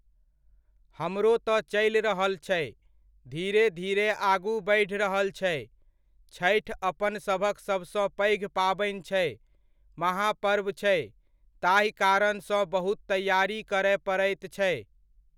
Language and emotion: Maithili, neutral